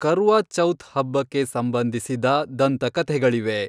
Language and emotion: Kannada, neutral